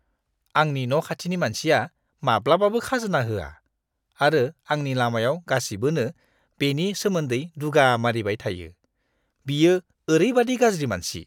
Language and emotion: Bodo, disgusted